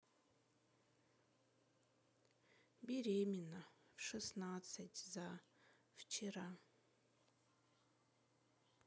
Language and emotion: Russian, sad